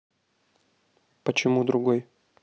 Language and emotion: Russian, neutral